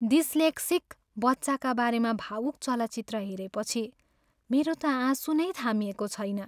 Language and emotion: Nepali, sad